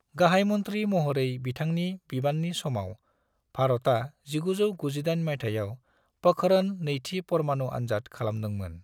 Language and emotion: Bodo, neutral